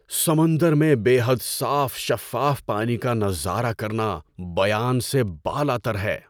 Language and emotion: Urdu, surprised